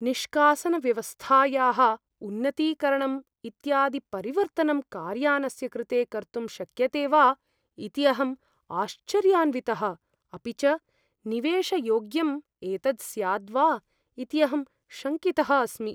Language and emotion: Sanskrit, fearful